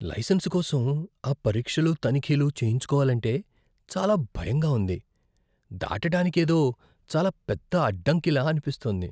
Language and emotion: Telugu, fearful